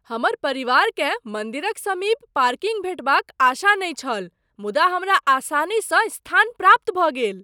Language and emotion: Maithili, surprised